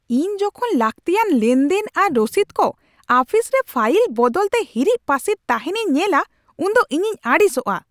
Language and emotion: Santali, angry